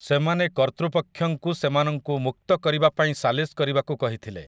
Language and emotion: Odia, neutral